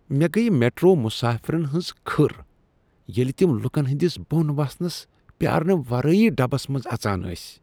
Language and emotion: Kashmiri, disgusted